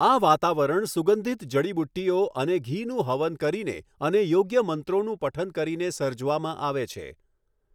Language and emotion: Gujarati, neutral